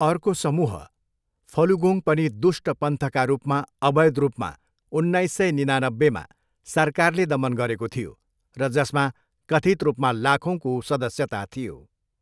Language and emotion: Nepali, neutral